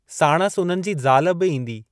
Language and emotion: Sindhi, neutral